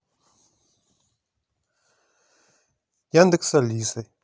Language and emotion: Russian, neutral